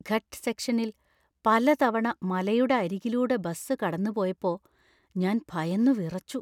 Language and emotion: Malayalam, fearful